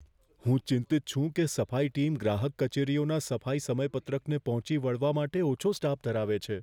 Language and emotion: Gujarati, fearful